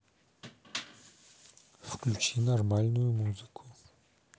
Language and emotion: Russian, neutral